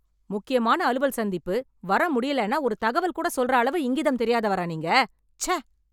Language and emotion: Tamil, angry